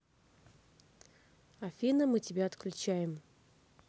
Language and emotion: Russian, neutral